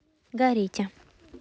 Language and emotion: Russian, neutral